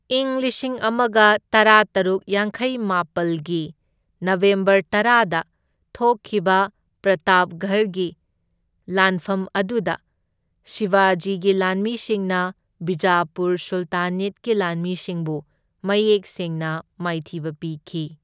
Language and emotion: Manipuri, neutral